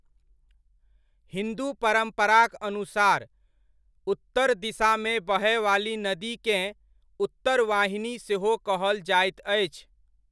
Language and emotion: Maithili, neutral